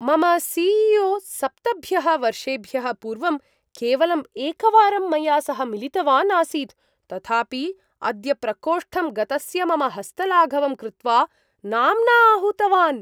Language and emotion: Sanskrit, surprised